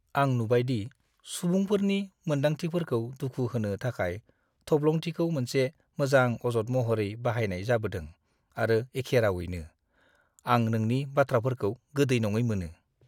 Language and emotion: Bodo, disgusted